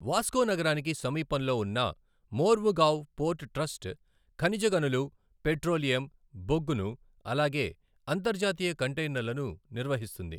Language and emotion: Telugu, neutral